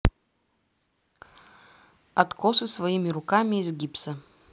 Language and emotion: Russian, neutral